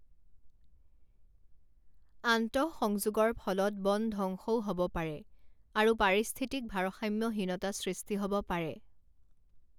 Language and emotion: Assamese, neutral